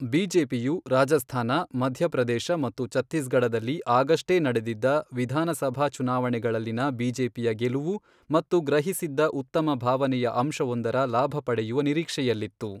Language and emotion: Kannada, neutral